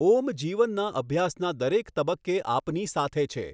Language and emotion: Gujarati, neutral